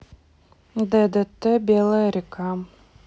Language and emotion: Russian, neutral